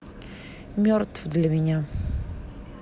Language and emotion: Russian, sad